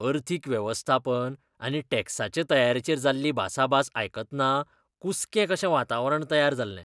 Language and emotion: Goan Konkani, disgusted